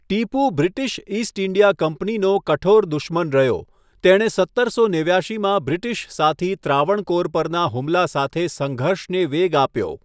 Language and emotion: Gujarati, neutral